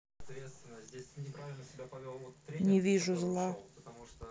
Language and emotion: Russian, neutral